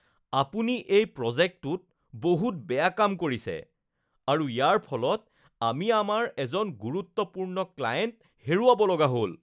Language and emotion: Assamese, disgusted